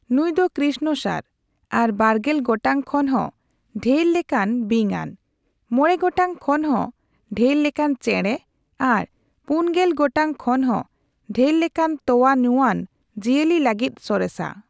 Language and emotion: Santali, neutral